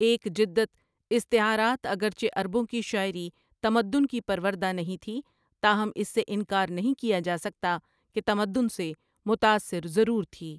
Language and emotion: Urdu, neutral